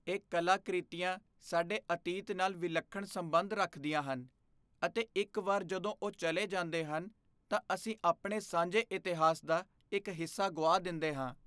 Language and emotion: Punjabi, fearful